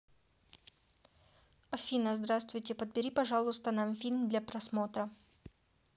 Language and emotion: Russian, neutral